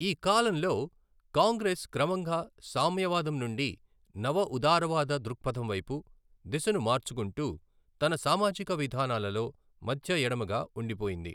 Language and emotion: Telugu, neutral